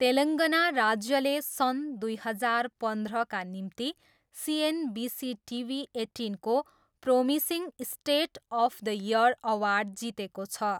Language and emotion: Nepali, neutral